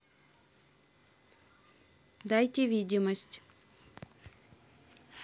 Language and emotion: Russian, neutral